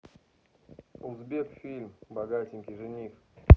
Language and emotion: Russian, neutral